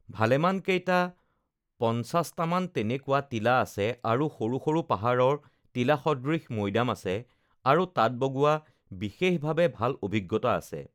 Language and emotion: Assamese, neutral